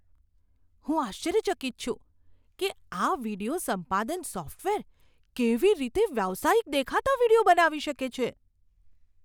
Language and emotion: Gujarati, surprised